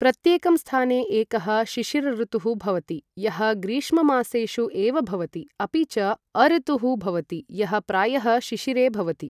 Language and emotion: Sanskrit, neutral